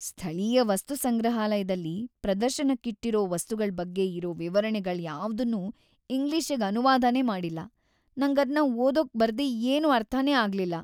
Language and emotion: Kannada, sad